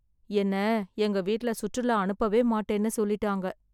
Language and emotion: Tamil, sad